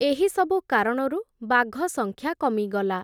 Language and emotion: Odia, neutral